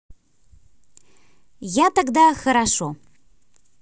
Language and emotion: Russian, neutral